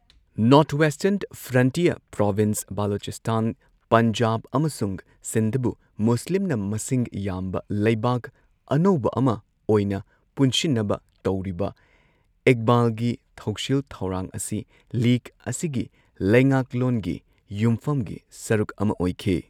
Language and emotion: Manipuri, neutral